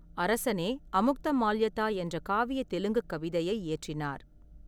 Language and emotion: Tamil, neutral